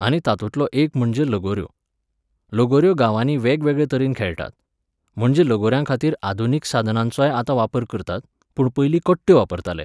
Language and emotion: Goan Konkani, neutral